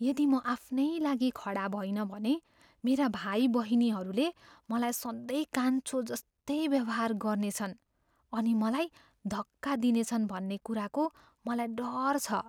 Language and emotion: Nepali, fearful